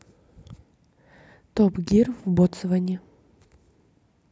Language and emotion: Russian, neutral